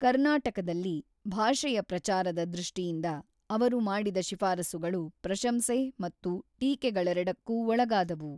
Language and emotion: Kannada, neutral